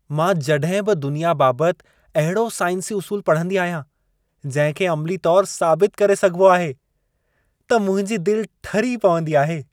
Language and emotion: Sindhi, happy